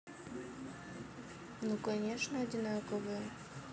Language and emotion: Russian, neutral